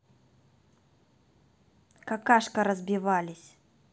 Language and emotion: Russian, angry